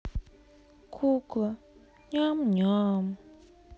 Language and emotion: Russian, sad